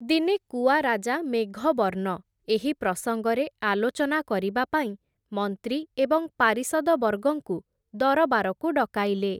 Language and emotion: Odia, neutral